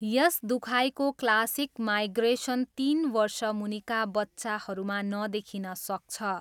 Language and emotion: Nepali, neutral